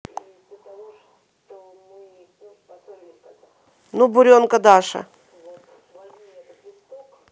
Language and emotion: Russian, neutral